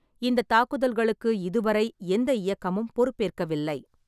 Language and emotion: Tamil, neutral